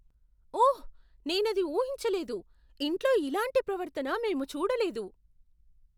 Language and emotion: Telugu, surprised